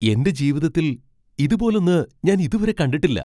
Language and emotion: Malayalam, surprised